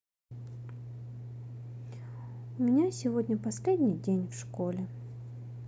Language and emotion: Russian, sad